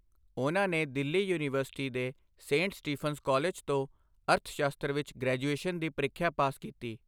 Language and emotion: Punjabi, neutral